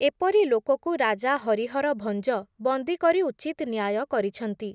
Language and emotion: Odia, neutral